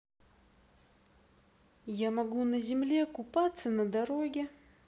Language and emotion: Russian, neutral